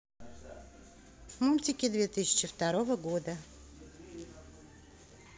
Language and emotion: Russian, neutral